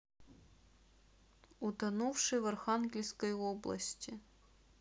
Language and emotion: Russian, neutral